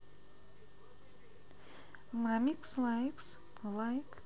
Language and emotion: Russian, neutral